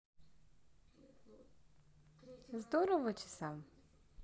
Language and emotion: Russian, positive